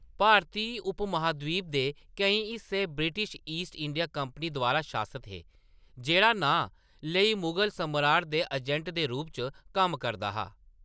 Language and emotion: Dogri, neutral